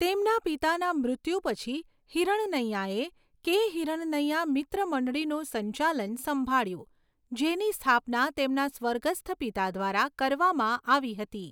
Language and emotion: Gujarati, neutral